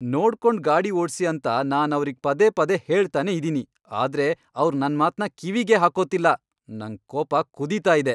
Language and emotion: Kannada, angry